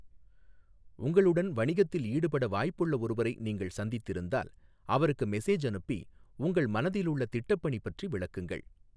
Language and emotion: Tamil, neutral